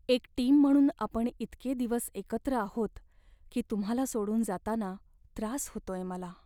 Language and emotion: Marathi, sad